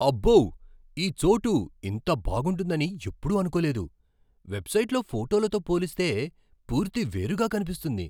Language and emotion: Telugu, surprised